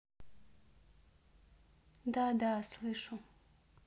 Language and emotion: Russian, neutral